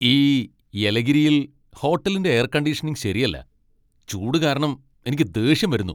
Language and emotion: Malayalam, angry